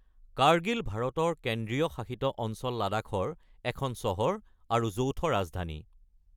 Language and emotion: Assamese, neutral